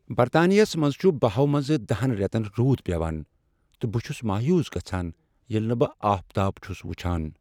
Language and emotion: Kashmiri, sad